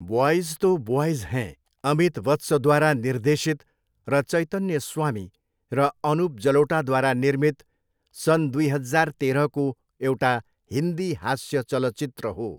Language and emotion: Nepali, neutral